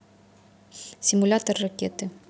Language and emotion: Russian, neutral